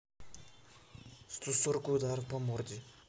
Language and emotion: Russian, neutral